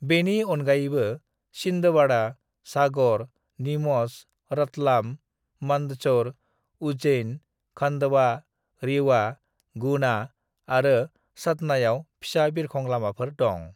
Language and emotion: Bodo, neutral